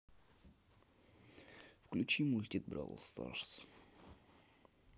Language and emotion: Russian, neutral